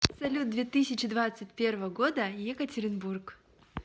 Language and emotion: Russian, positive